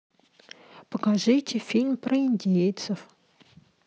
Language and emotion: Russian, neutral